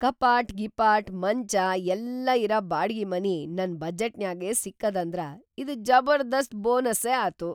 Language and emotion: Kannada, surprised